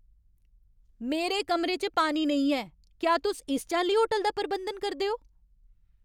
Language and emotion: Dogri, angry